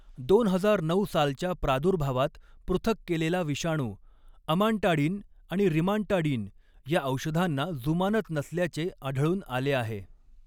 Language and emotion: Marathi, neutral